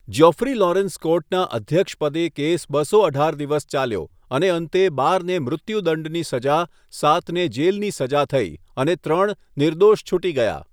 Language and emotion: Gujarati, neutral